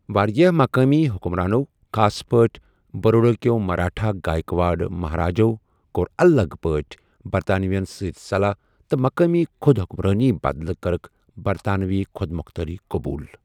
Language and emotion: Kashmiri, neutral